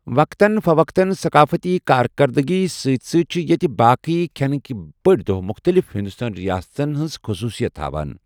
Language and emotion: Kashmiri, neutral